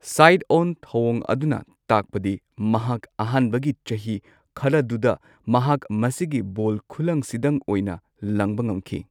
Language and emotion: Manipuri, neutral